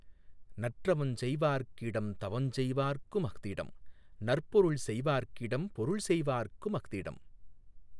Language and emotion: Tamil, neutral